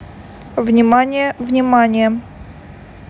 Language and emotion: Russian, neutral